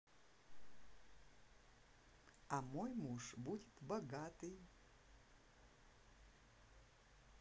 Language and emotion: Russian, positive